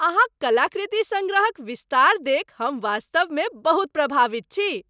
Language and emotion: Maithili, happy